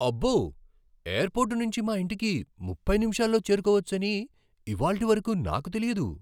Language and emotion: Telugu, surprised